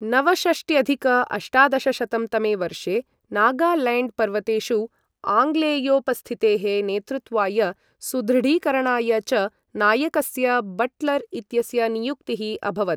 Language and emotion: Sanskrit, neutral